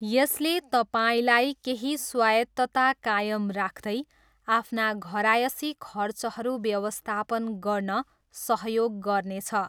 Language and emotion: Nepali, neutral